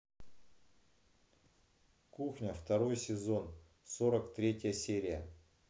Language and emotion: Russian, neutral